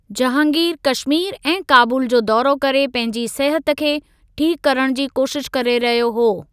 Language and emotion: Sindhi, neutral